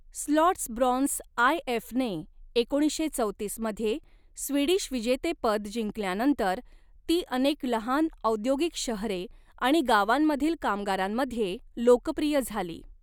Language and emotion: Marathi, neutral